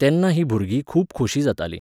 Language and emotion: Goan Konkani, neutral